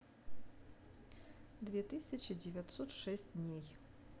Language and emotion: Russian, neutral